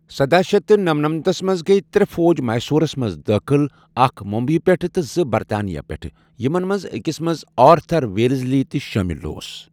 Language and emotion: Kashmiri, neutral